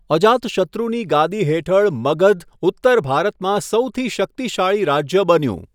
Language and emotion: Gujarati, neutral